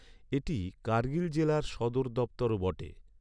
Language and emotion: Bengali, neutral